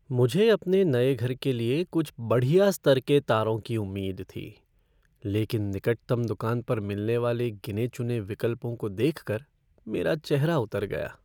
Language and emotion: Hindi, sad